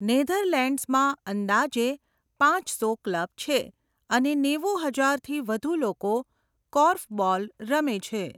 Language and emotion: Gujarati, neutral